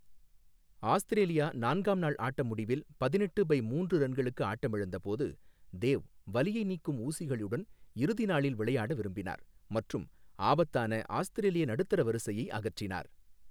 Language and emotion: Tamil, neutral